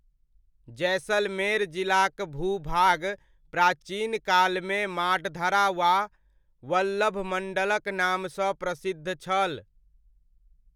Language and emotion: Maithili, neutral